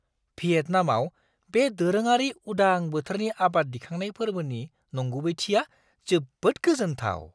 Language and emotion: Bodo, surprised